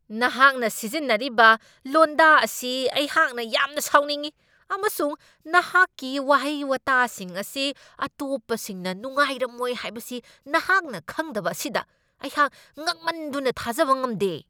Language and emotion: Manipuri, angry